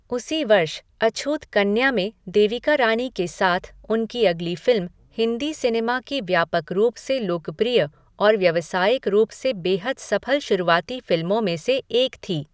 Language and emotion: Hindi, neutral